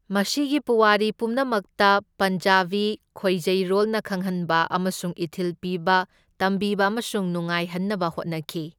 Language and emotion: Manipuri, neutral